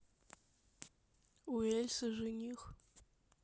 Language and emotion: Russian, sad